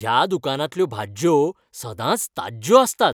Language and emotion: Goan Konkani, happy